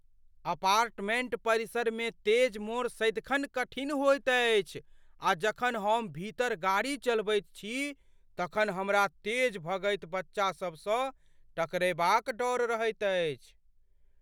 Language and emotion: Maithili, fearful